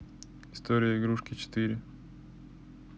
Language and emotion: Russian, neutral